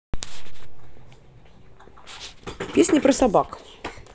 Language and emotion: Russian, neutral